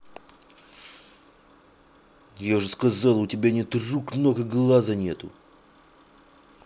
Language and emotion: Russian, angry